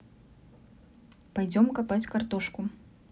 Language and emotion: Russian, neutral